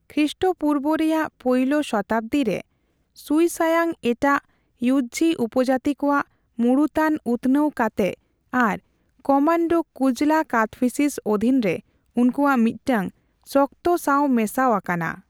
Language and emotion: Santali, neutral